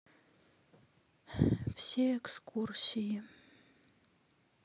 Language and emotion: Russian, sad